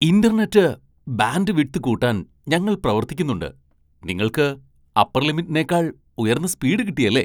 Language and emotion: Malayalam, surprised